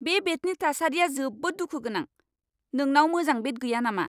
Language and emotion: Bodo, angry